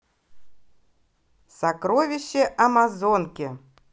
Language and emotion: Russian, positive